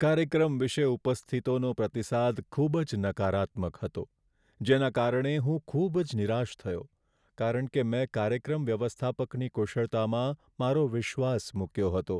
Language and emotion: Gujarati, sad